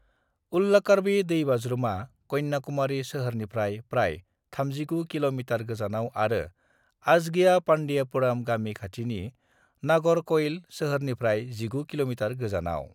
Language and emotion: Bodo, neutral